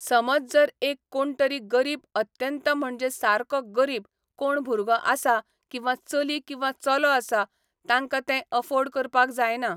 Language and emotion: Goan Konkani, neutral